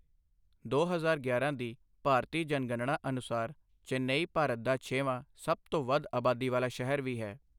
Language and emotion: Punjabi, neutral